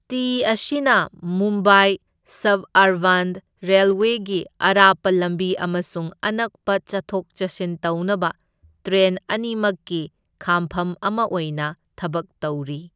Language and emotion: Manipuri, neutral